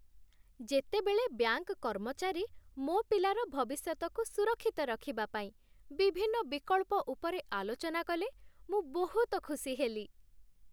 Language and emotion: Odia, happy